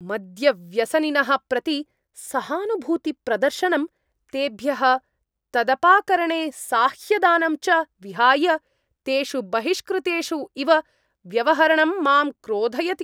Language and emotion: Sanskrit, angry